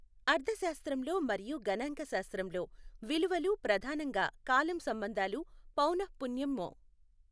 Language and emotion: Telugu, neutral